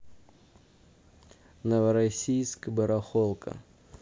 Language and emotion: Russian, neutral